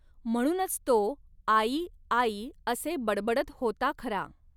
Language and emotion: Marathi, neutral